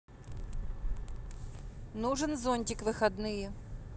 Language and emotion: Russian, neutral